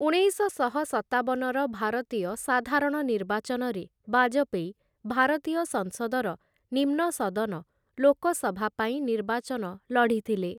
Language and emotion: Odia, neutral